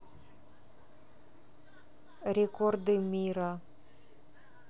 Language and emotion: Russian, neutral